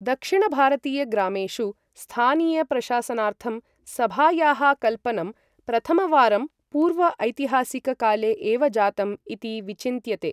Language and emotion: Sanskrit, neutral